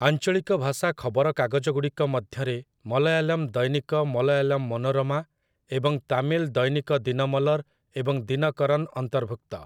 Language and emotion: Odia, neutral